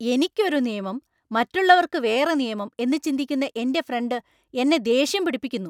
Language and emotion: Malayalam, angry